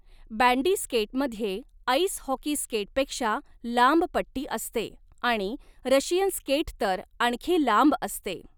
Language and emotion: Marathi, neutral